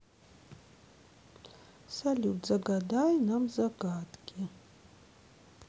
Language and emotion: Russian, sad